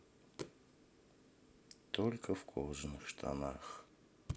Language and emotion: Russian, sad